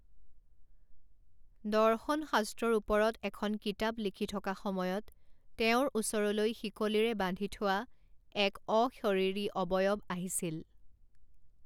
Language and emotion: Assamese, neutral